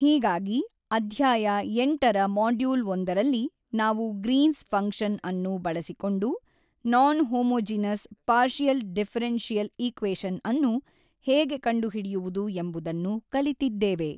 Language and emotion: Kannada, neutral